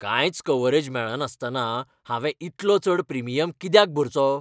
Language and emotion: Goan Konkani, angry